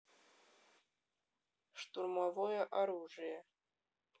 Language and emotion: Russian, neutral